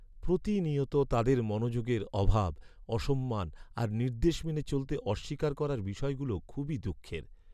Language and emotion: Bengali, sad